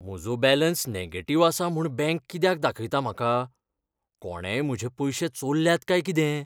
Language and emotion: Goan Konkani, fearful